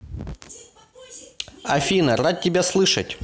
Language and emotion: Russian, positive